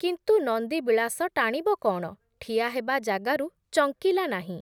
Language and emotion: Odia, neutral